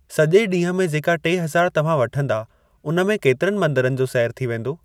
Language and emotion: Sindhi, neutral